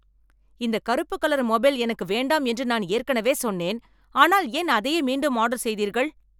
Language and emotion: Tamil, angry